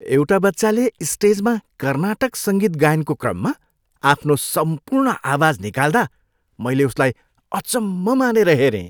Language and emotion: Nepali, happy